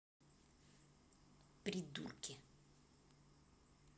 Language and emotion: Russian, angry